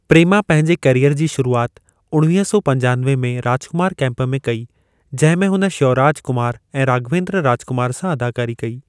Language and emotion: Sindhi, neutral